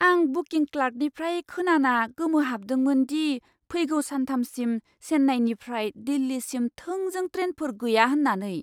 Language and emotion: Bodo, surprised